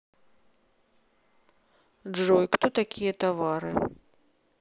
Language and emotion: Russian, neutral